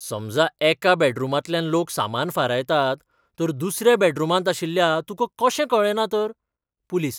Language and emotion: Goan Konkani, surprised